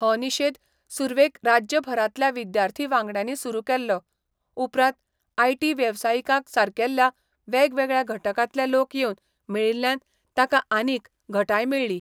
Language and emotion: Goan Konkani, neutral